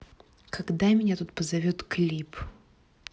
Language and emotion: Russian, angry